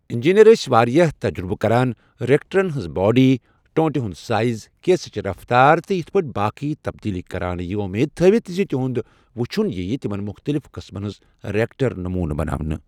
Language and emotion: Kashmiri, neutral